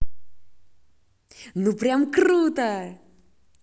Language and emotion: Russian, positive